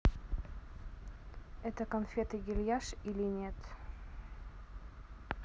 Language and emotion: Russian, neutral